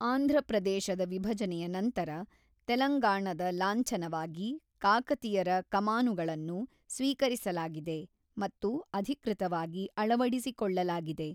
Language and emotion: Kannada, neutral